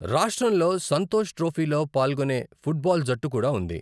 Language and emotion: Telugu, neutral